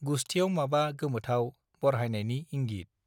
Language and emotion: Bodo, neutral